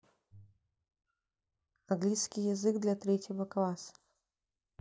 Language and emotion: Russian, neutral